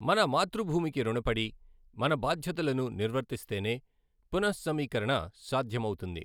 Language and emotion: Telugu, neutral